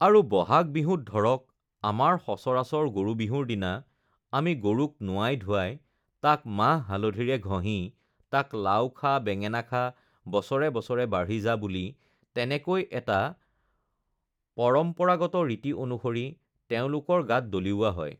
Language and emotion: Assamese, neutral